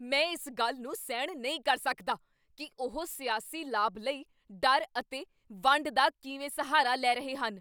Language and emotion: Punjabi, angry